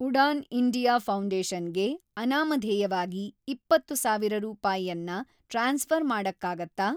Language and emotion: Kannada, neutral